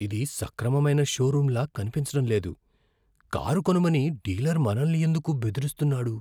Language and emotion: Telugu, fearful